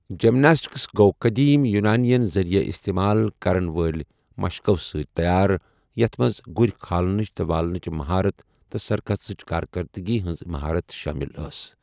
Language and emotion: Kashmiri, neutral